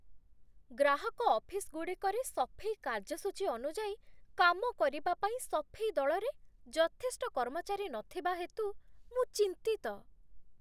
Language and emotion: Odia, fearful